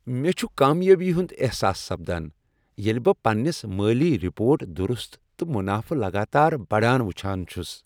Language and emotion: Kashmiri, happy